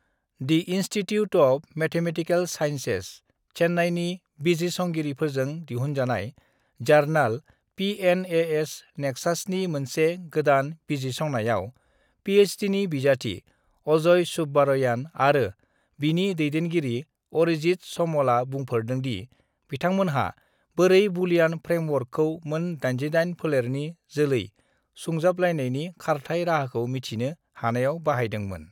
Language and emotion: Bodo, neutral